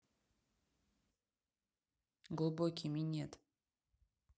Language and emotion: Russian, neutral